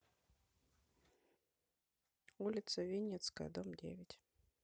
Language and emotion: Russian, neutral